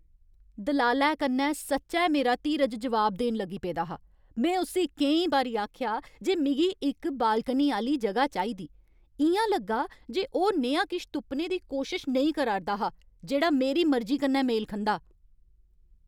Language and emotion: Dogri, angry